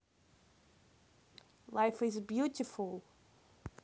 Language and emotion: Russian, neutral